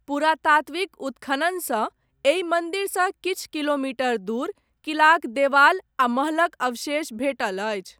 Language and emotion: Maithili, neutral